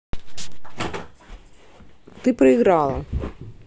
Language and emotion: Russian, neutral